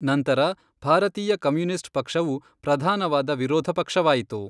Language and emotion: Kannada, neutral